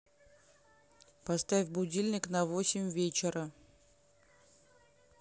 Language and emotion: Russian, neutral